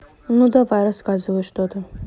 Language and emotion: Russian, neutral